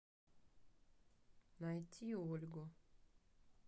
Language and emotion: Russian, neutral